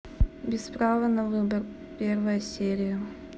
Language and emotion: Russian, neutral